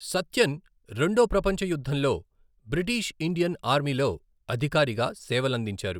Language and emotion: Telugu, neutral